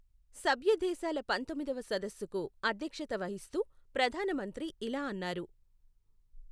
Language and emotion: Telugu, neutral